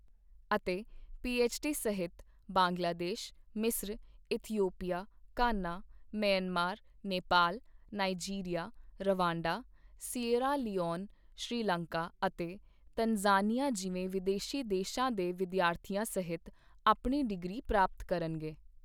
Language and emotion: Punjabi, neutral